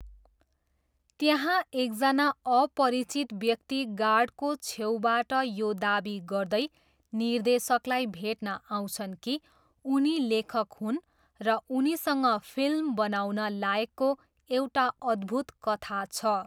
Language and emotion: Nepali, neutral